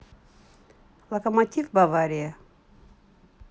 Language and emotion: Russian, neutral